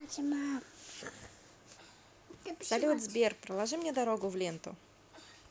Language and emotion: Russian, positive